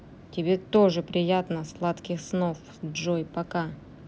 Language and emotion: Russian, neutral